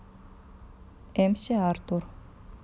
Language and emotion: Russian, neutral